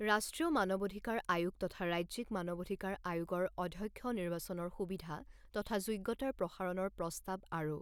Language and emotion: Assamese, neutral